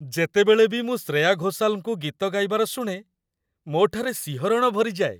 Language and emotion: Odia, happy